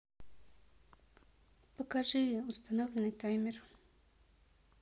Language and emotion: Russian, neutral